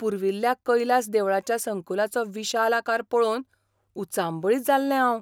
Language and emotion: Goan Konkani, surprised